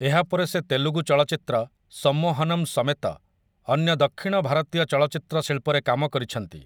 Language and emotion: Odia, neutral